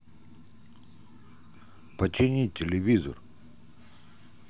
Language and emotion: Russian, neutral